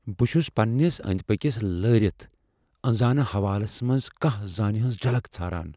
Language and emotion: Kashmiri, fearful